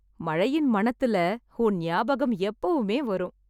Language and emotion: Tamil, happy